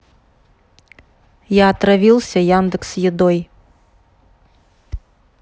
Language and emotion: Russian, neutral